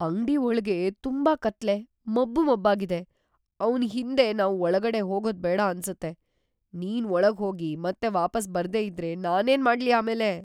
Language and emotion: Kannada, fearful